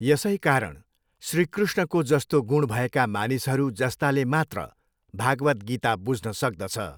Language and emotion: Nepali, neutral